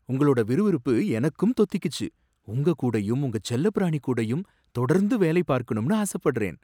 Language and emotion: Tamil, surprised